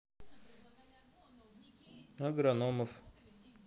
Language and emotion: Russian, neutral